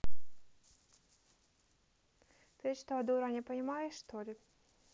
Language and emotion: Russian, neutral